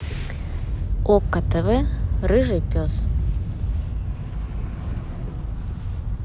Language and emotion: Russian, positive